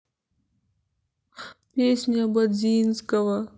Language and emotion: Russian, sad